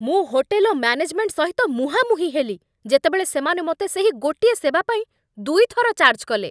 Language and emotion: Odia, angry